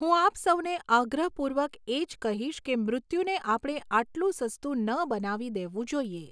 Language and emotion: Gujarati, neutral